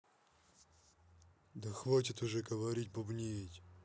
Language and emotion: Russian, angry